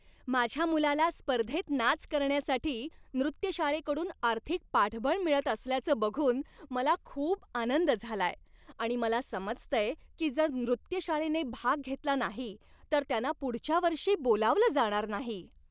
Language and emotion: Marathi, happy